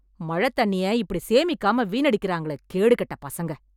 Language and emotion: Tamil, angry